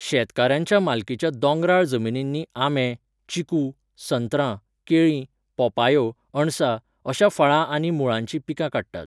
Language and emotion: Goan Konkani, neutral